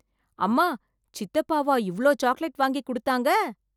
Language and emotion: Tamil, surprised